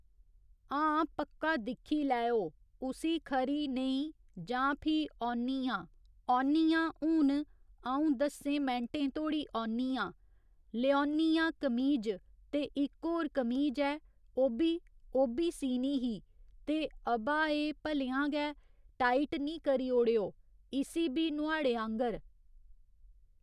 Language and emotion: Dogri, neutral